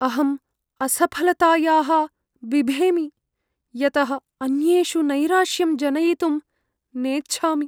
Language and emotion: Sanskrit, fearful